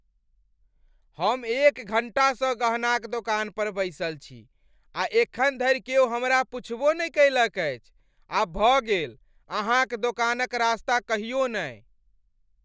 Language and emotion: Maithili, angry